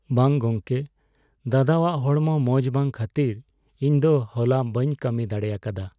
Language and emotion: Santali, sad